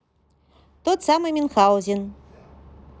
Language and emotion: Russian, positive